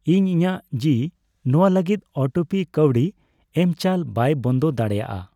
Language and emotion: Santali, neutral